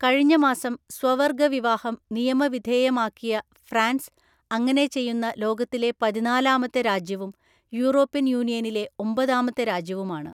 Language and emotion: Malayalam, neutral